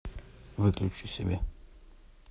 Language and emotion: Russian, neutral